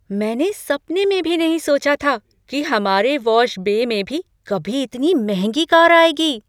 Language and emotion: Hindi, surprised